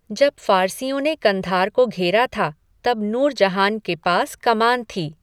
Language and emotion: Hindi, neutral